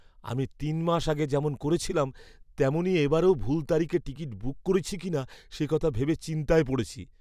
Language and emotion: Bengali, fearful